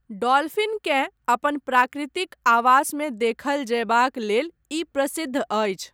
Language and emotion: Maithili, neutral